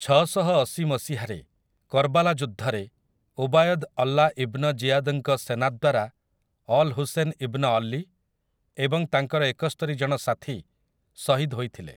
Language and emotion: Odia, neutral